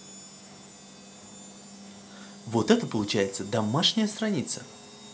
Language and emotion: Russian, positive